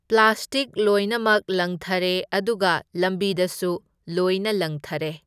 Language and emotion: Manipuri, neutral